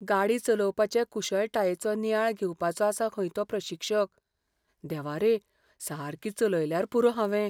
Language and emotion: Goan Konkani, fearful